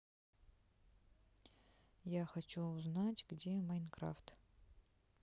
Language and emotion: Russian, neutral